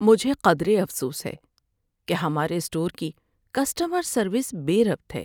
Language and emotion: Urdu, sad